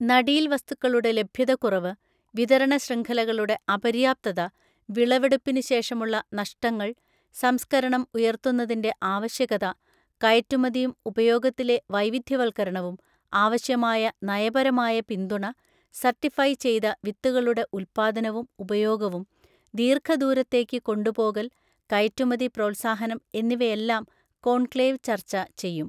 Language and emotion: Malayalam, neutral